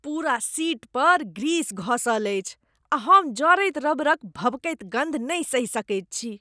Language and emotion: Maithili, disgusted